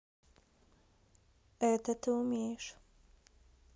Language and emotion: Russian, neutral